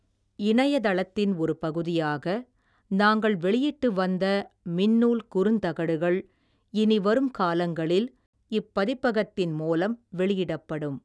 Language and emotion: Tamil, neutral